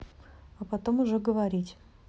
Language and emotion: Russian, neutral